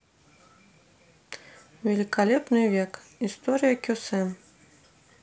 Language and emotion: Russian, neutral